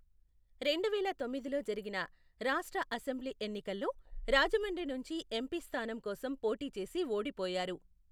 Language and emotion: Telugu, neutral